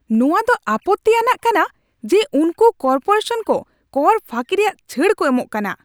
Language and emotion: Santali, angry